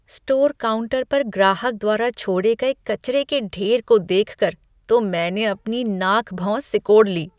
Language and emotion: Hindi, disgusted